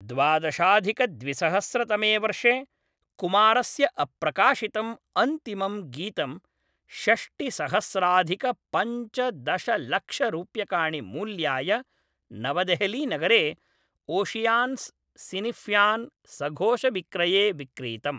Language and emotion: Sanskrit, neutral